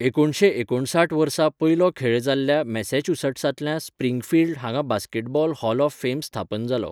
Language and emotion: Goan Konkani, neutral